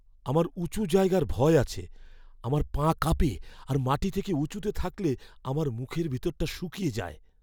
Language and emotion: Bengali, fearful